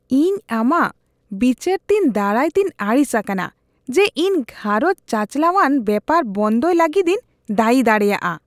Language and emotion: Santali, disgusted